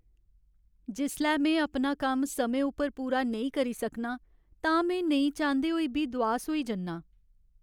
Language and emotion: Dogri, sad